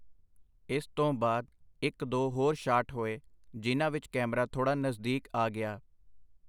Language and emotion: Punjabi, neutral